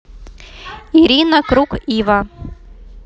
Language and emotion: Russian, neutral